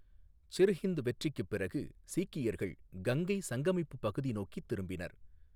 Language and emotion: Tamil, neutral